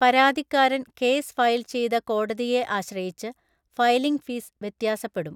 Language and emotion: Malayalam, neutral